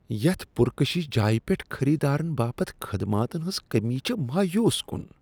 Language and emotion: Kashmiri, disgusted